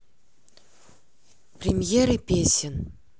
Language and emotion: Russian, neutral